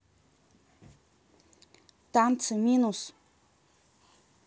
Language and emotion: Russian, neutral